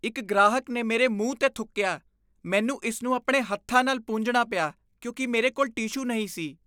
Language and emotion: Punjabi, disgusted